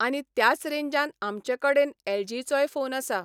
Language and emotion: Goan Konkani, neutral